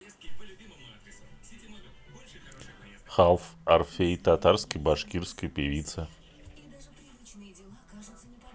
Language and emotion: Russian, neutral